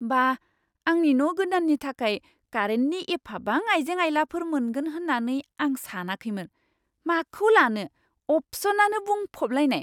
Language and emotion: Bodo, surprised